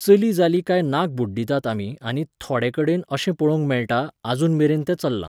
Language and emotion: Goan Konkani, neutral